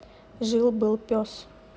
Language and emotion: Russian, neutral